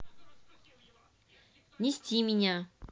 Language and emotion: Russian, neutral